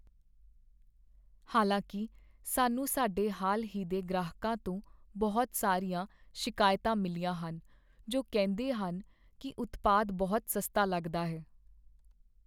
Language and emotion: Punjabi, sad